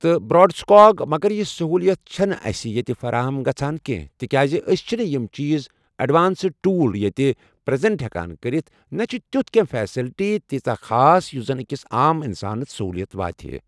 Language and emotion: Kashmiri, neutral